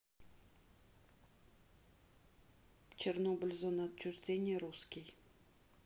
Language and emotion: Russian, neutral